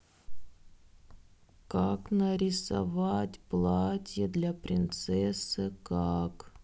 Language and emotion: Russian, sad